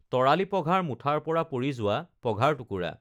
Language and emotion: Assamese, neutral